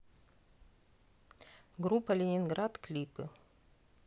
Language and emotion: Russian, neutral